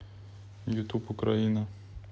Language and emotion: Russian, neutral